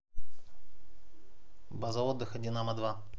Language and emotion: Russian, neutral